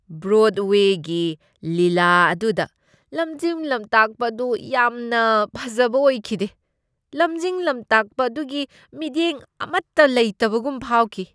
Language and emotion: Manipuri, disgusted